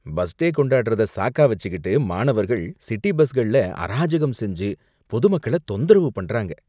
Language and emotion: Tamil, disgusted